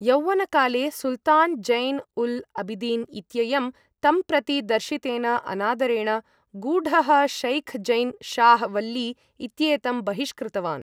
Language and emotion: Sanskrit, neutral